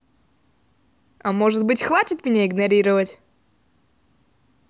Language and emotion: Russian, angry